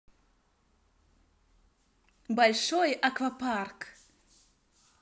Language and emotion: Russian, positive